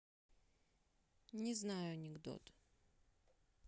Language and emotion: Russian, neutral